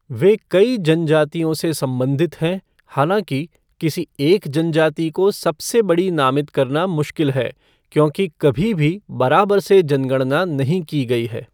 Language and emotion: Hindi, neutral